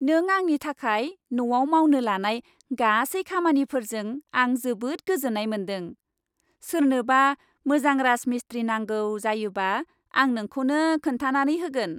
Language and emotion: Bodo, happy